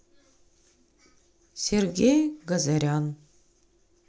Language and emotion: Russian, neutral